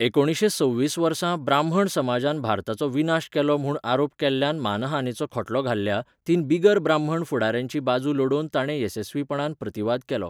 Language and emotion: Goan Konkani, neutral